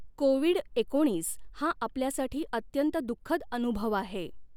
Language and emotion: Marathi, neutral